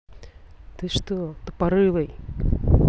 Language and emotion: Russian, angry